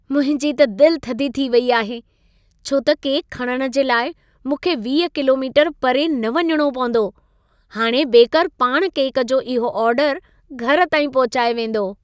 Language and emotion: Sindhi, happy